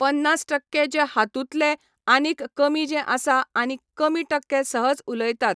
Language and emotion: Goan Konkani, neutral